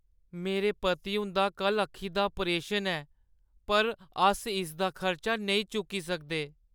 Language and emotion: Dogri, sad